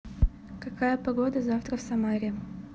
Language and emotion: Russian, neutral